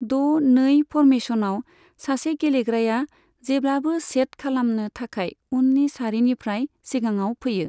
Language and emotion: Bodo, neutral